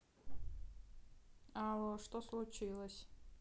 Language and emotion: Russian, neutral